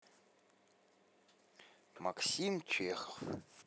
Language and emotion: Russian, neutral